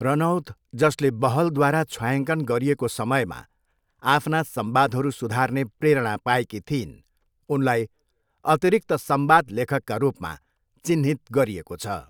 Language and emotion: Nepali, neutral